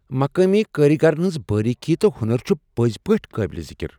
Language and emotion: Kashmiri, surprised